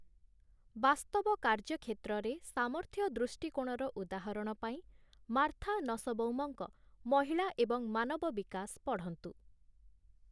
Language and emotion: Odia, neutral